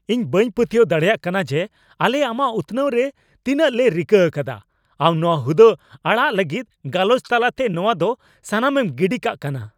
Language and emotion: Santali, angry